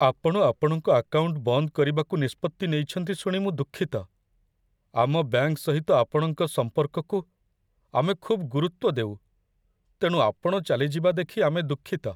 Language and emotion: Odia, sad